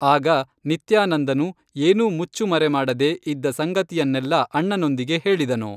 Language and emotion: Kannada, neutral